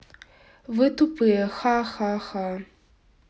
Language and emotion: Russian, neutral